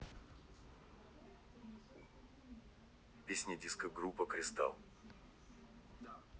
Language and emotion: Russian, neutral